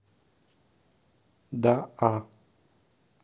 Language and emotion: Russian, neutral